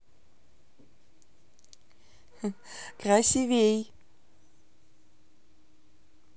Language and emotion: Russian, positive